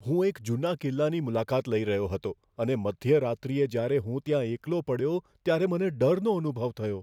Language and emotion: Gujarati, fearful